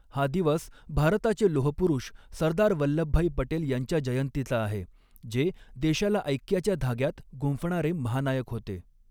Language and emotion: Marathi, neutral